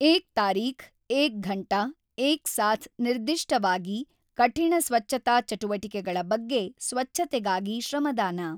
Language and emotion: Kannada, neutral